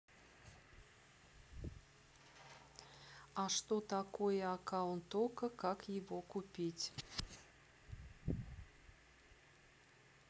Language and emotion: Russian, neutral